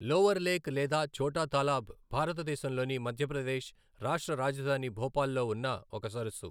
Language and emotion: Telugu, neutral